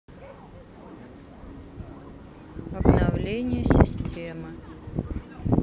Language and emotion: Russian, neutral